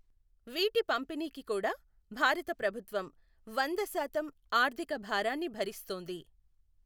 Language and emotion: Telugu, neutral